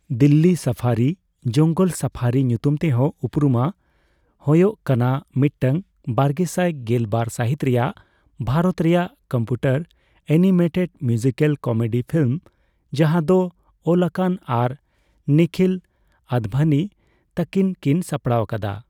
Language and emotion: Santali, neutral